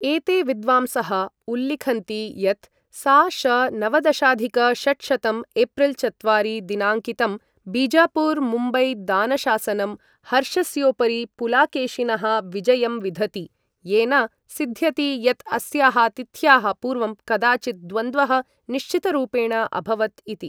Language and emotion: Sanskrit, neutral